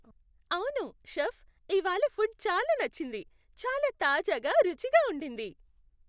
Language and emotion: Telugu, happy